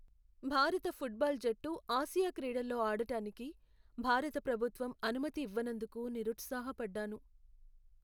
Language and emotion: Telugu, sad